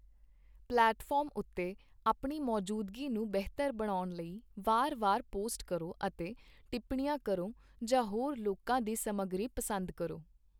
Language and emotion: Punjabi, neutral